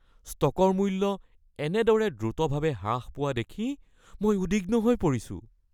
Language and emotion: Assamese, fearful